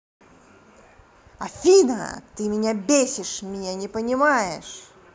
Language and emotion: Russian, angry